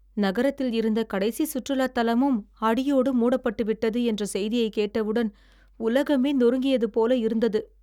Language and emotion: Tamil, sad